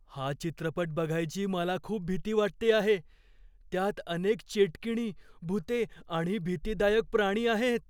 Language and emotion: Marathi, fearful